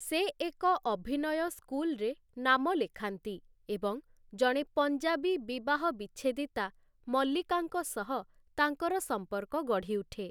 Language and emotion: Odia, neutral